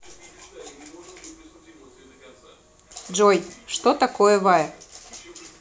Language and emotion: Russian, neutral